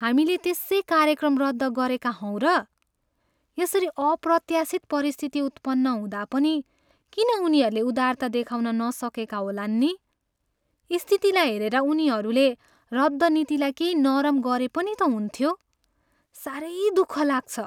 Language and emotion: Nepali, sad